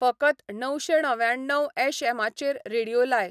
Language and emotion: Goan Konkani, neutral